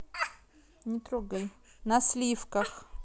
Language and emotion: Russian, neutral